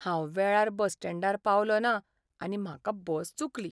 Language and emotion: Goan Konkani, sad